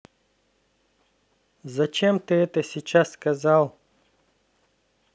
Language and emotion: Russian, neutral